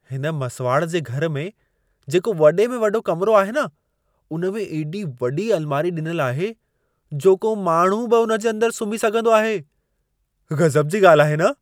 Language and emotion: Sindhi, surprised